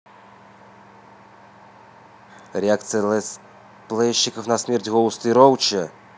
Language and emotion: Russian, neutral